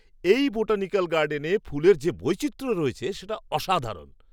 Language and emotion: Bengali, surprised